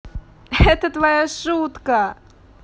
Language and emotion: Russian, positive